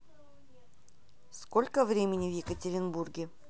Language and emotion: Russian, neutral